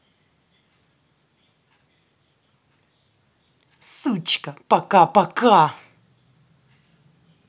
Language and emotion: Russian, angry